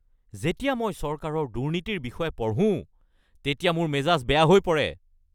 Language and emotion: Assamese, angry